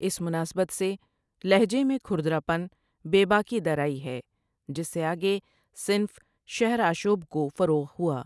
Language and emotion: Urdu, neutral